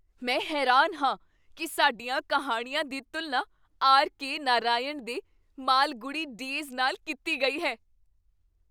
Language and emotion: Punjabi, surprised